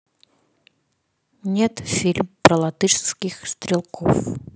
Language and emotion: Russian, neutral